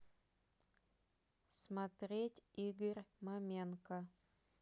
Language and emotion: Russian, neutral